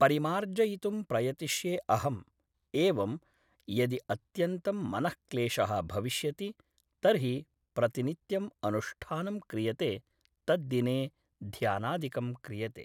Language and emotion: Sanskrit, neutral